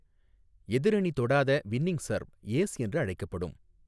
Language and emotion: Tamil, neutral